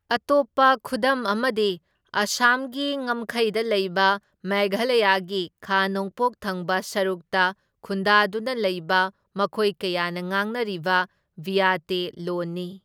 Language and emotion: Manipuri, neutral